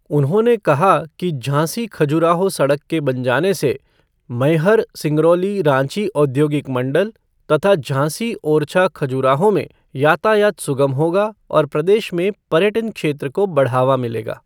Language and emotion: Hindi, neutral